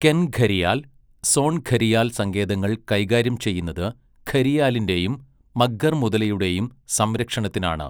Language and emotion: Malayalam, neutral